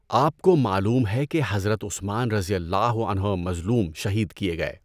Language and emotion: Urdu, neutral